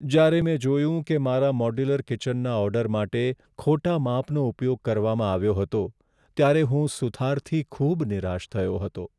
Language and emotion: Gujarati, sad